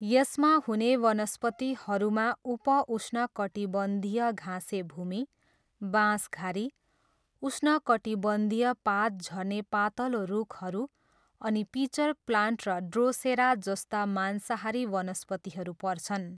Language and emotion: Nepali, neutral